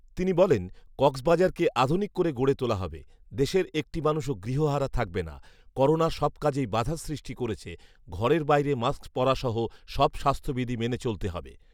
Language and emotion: Bengali, neutral